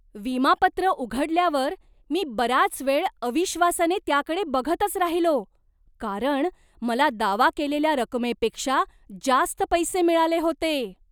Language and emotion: Marathi, surprised